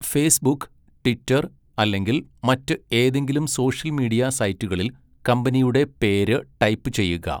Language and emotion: Malayalam, neutral